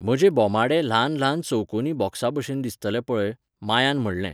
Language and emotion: Goan Konkani, neutral